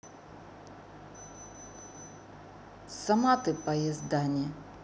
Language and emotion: Russian, angry